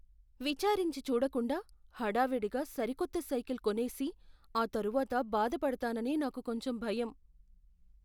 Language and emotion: Telugu, fearful